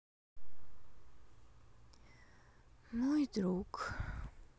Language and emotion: Russian, sad